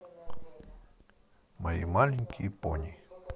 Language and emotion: Russian, neutral